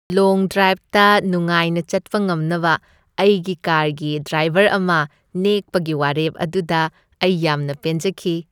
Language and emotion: Manipuri, happy